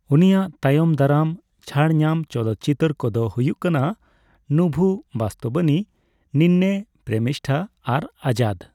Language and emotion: Santali, neutral